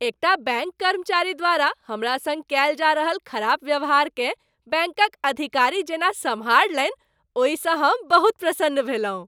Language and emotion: Maithili, happy